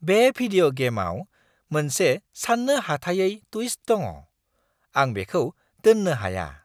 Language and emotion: Bodo, surprised